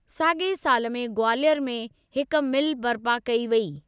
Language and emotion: Sindhi, neutral